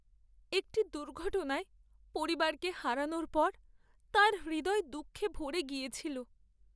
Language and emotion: Bengali, sad